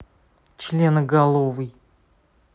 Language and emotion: Russian, angry